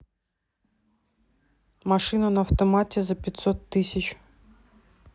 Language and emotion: Russian, neutral